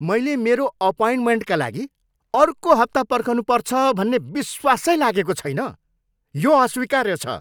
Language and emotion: Nepali, angry